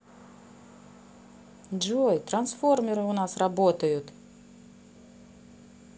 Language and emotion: Russian, positive